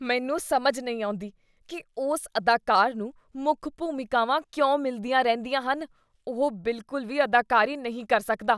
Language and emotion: Punjabi, disgusted